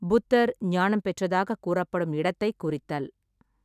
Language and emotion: Tamil, neutral